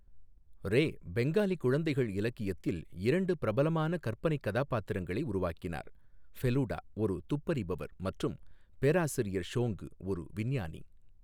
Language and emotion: Tamil, neutral